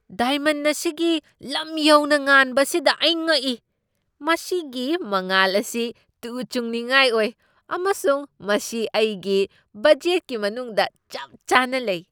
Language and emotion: Manipuri, surprised